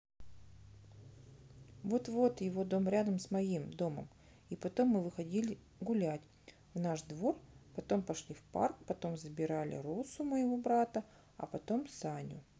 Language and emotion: Russian, neutral